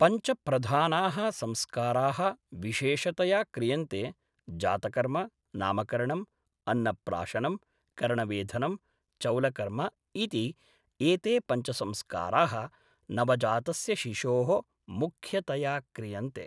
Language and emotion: Sanskrit, neutral